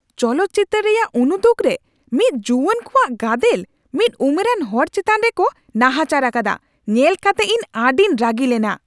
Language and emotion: Santali, angry